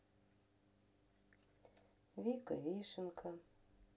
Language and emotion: Russian, sad